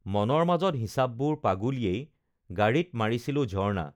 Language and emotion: Assamese, neutral